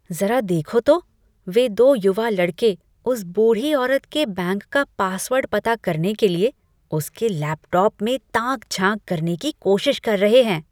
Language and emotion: Hindi, disgusted